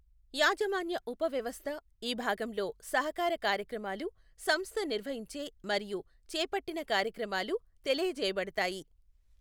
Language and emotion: Telugu, neutral